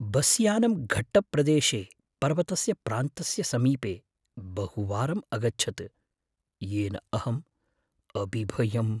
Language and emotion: Sanskrit, fearful